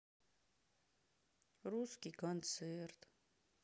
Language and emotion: Russian, sad